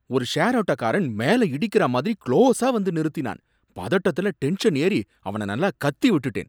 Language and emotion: Tamil, angry